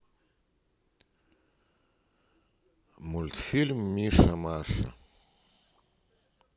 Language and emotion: Russian, neutral